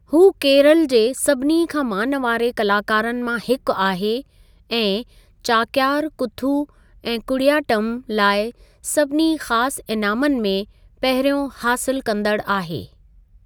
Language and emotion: Sindhi, neutral